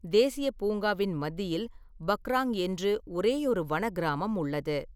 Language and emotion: Tamil, neutral